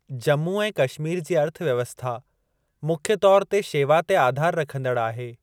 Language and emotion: Sindhi, neutral